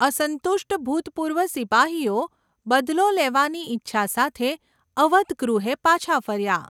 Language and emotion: Gujarati, neutral